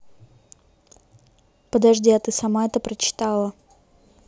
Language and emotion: Russian, neutral